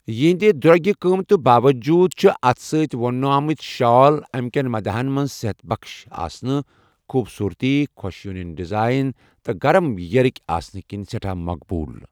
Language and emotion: Kashmiri, neutral